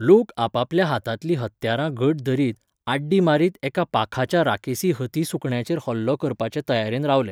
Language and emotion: Goan Konkani, neutral